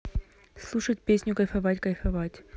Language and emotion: Russian, neutral